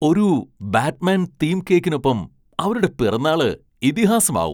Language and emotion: Malayalam, surprised